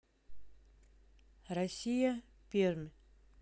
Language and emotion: Russian, neutral